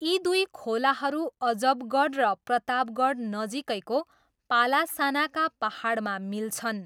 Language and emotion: Nepali, neutral